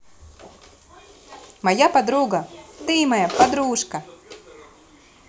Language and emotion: Russian, positive